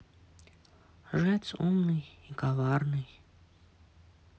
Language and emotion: Russian, sad